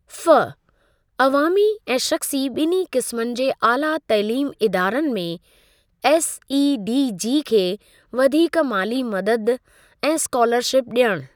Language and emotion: Sindhi, neutral